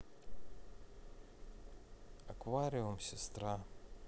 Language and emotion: Russian, neutral